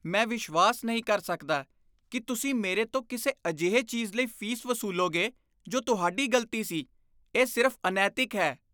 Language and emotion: Punjabi, disgusted